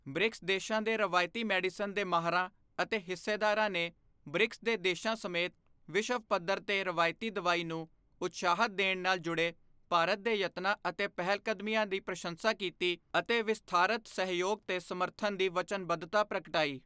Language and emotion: Punjabi, neutral